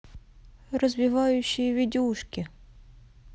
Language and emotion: Russian, neutral